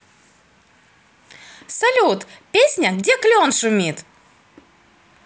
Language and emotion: Russian, positive